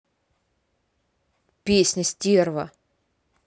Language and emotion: Russian, angry